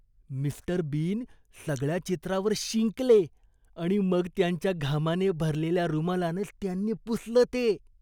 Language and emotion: Marathi, disgusted